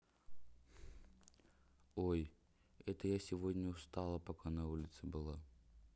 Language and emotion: Russian, sad